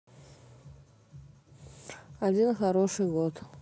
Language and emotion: Russian, neutral